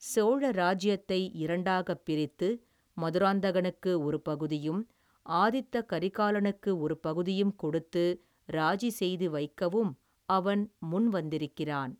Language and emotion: Tamil, neutral